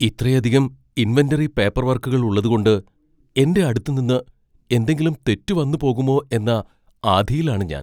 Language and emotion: Malayalam, fearful